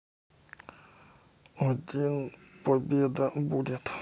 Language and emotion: Russian, neutral